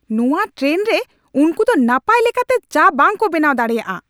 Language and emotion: Santali, angry